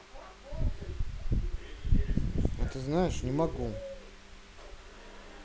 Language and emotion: Russian, neutral